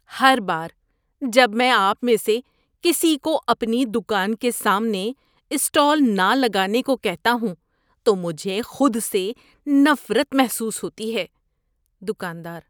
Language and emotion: Urdu, disgusted